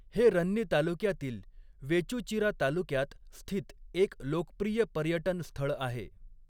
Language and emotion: Marathi, neutral